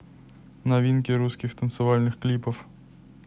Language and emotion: Russian, neutral